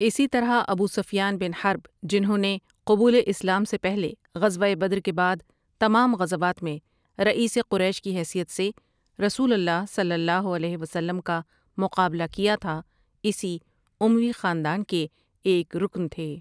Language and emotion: Urdu, neutral